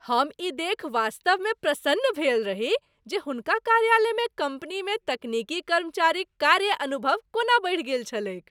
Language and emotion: Maithili, happy